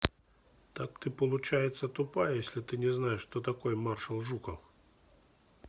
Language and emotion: Russian, neutral